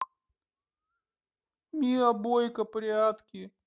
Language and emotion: Russian, sad